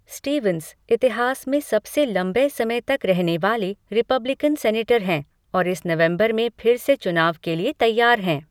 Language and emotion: Hindi, neutral